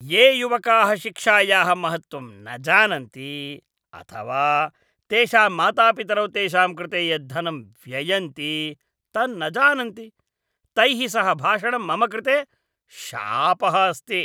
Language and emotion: Sanskrit, disgusted